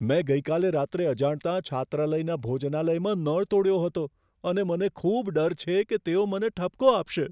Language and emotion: Gujarati, fearful